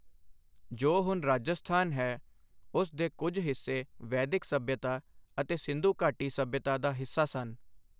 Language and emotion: Punjabi, neutral